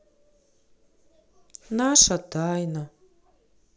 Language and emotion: Russian, sad